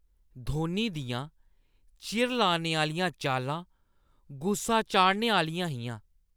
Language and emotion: Dogri, disgusted